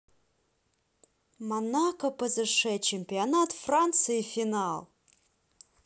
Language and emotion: Russian, neutral